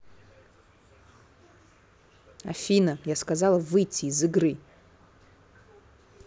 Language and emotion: Russian, angry